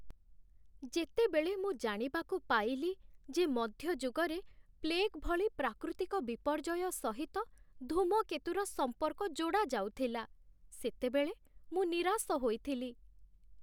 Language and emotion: Odia, sad